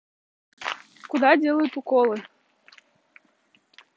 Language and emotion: Russian, neutral